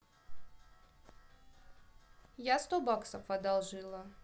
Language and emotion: Russian, neutral